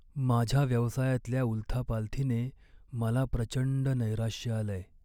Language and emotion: Marathi, sad